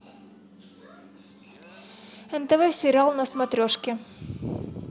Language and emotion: Russian, neutral